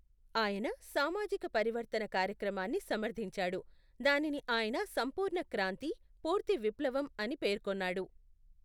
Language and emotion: Telugu, neutral